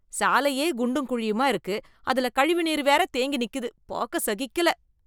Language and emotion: Tamil, disgusted